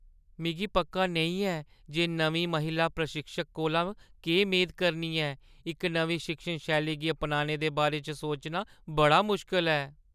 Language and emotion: Dogri, fearful